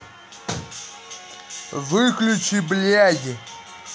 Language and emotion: Russian, angry